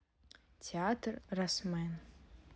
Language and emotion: Russian, neutral